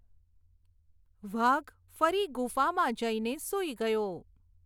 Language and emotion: Gujarati, neutral